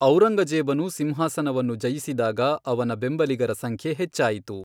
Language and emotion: Kannada, neutral